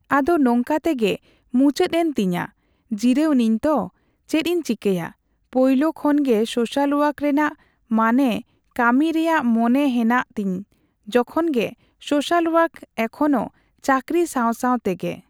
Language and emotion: Santali, neutral